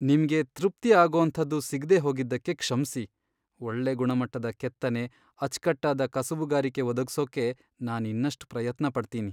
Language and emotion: Kannada, sad